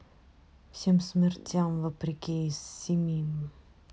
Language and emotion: Russian, neutral